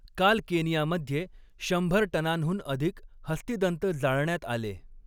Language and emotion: Marathi, neutral